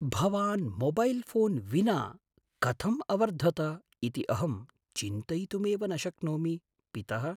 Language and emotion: Sanskrit, surprised